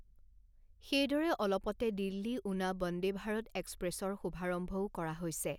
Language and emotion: Assamese, neutral